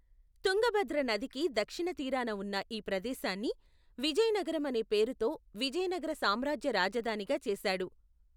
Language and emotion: Telugu, neutral